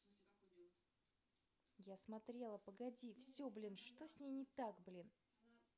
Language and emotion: Russian, angry